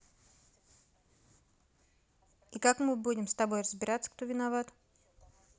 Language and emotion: Russian, neutral